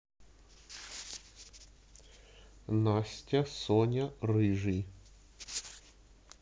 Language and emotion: Russian, neutral